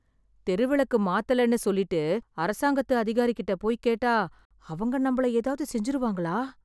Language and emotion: Tamil, fearful